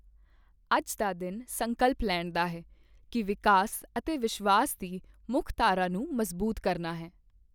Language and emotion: Punjabi, neutral